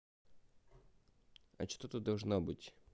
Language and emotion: Russian, neutral